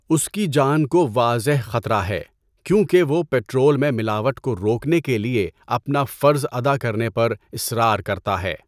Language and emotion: Urdu, neutral